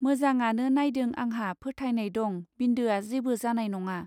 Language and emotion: Bodo, neutral